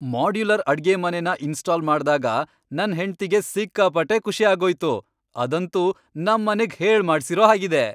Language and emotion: Kannada, happy